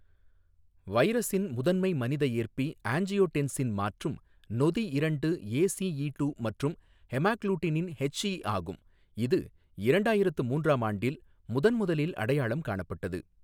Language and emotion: Tamil, neutral